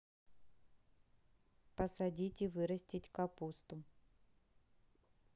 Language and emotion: Russian, neutral